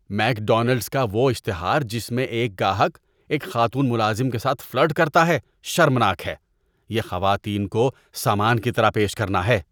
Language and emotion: Urdu, disgusted